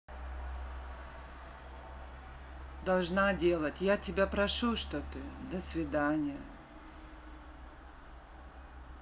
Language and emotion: Russian, sad